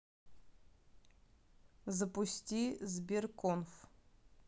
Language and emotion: Russian, neutral